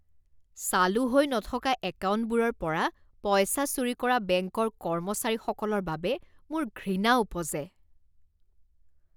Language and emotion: Assamese, disgusted